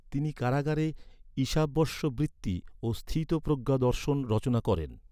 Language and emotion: Bengali, neutral